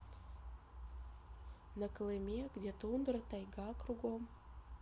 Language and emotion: Russian, neutral